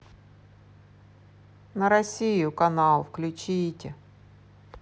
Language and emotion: Russian, neutral